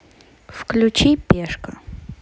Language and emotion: Russian, neutral